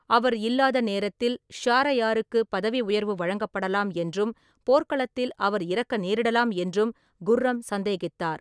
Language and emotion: Tamil, neutral